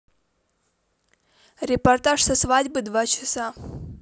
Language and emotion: Russian, neutral